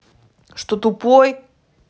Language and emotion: Russian, angry